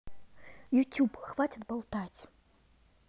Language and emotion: Russian, angry